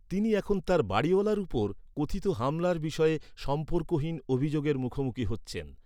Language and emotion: Bengali, neutral